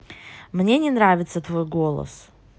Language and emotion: Russian, neutral